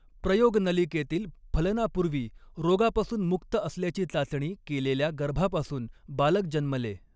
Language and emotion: Marathi, neutral